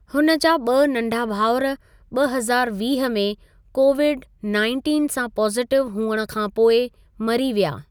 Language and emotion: Sindhi, neutral